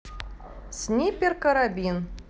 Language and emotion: Russian, neutral